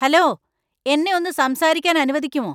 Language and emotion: Malayalam, angry